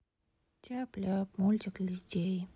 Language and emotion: Russian, sad